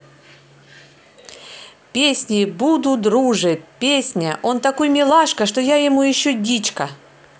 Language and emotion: Russian, positive